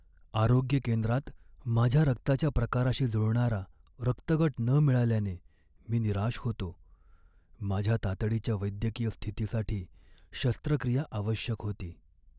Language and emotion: Marathi, sad